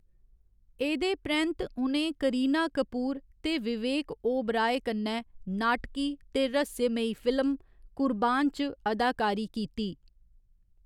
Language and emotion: Dogri, neutral